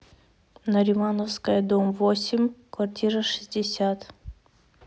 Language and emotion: Russian, neutral